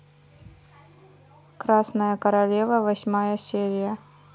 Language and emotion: Russian, neutral